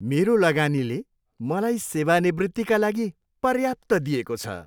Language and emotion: Nepali, happy